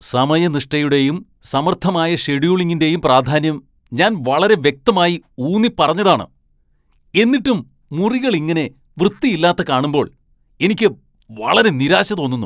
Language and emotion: Malayalam, angry